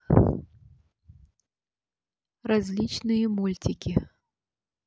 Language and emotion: Russian, neutral